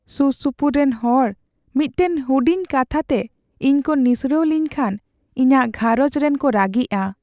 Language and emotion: Santali, sad